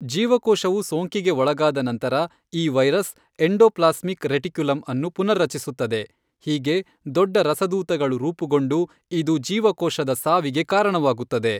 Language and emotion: Kannada, neutral